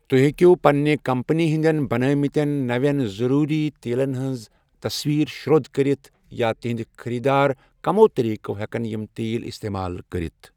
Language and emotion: Kashmiri, neutral